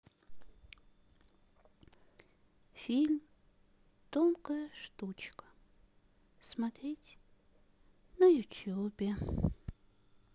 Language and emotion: Russian, sad